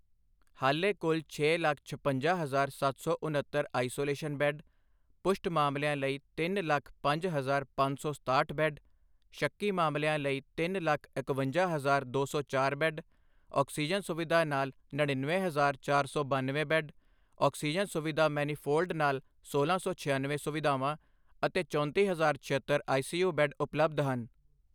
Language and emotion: Punjabi, neutral